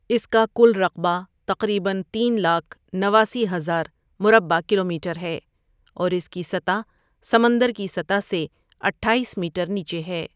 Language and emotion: Urdu, neutral